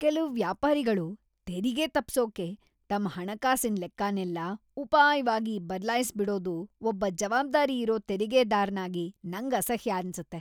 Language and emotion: Kannada, disgusted